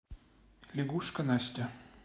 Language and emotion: Russian, neutral